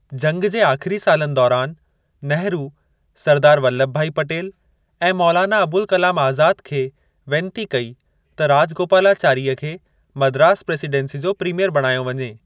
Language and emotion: Sindhi, neutral